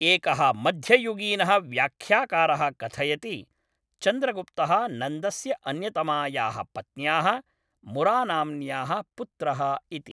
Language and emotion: Sanskrit, neutral